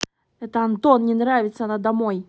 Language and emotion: Russian, angry